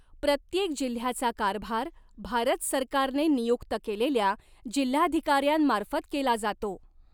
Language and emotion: Marathi, neutral